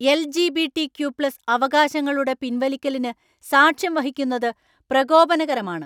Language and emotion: Malayalam, angry